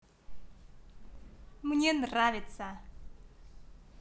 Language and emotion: Russian, positive